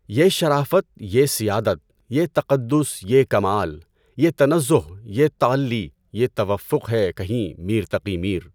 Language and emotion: Urdu, neutral